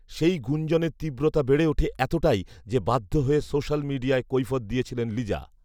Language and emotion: Bengali, neutral